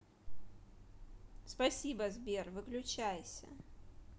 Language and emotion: Russian, neutral